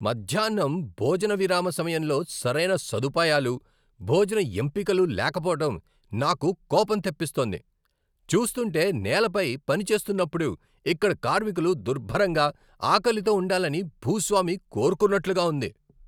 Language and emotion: Telugu, angry